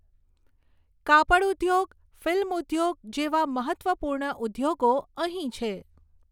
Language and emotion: Gujarati, neutral